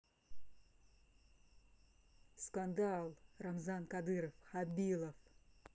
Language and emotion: Russian, neutral